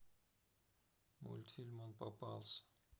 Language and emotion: Russian, sad